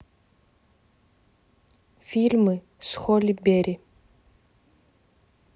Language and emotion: Russian, neutral